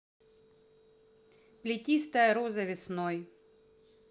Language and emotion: Russian, neutral